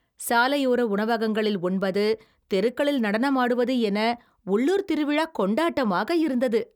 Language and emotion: Tamil, happy